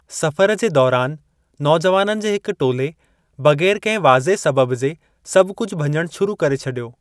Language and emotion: Sindhi, neutral